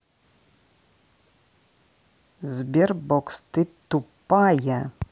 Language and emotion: Russian, angry